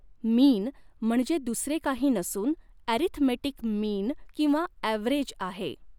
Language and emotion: Marathi, neutral